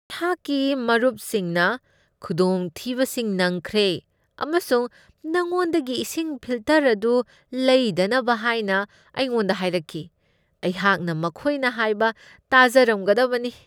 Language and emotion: Manipuri, disgusted